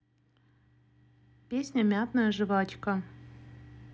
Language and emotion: Russian, neutral